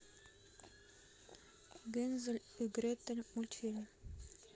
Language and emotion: Russian, neutral